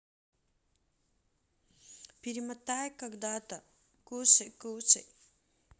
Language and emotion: Russian, neutral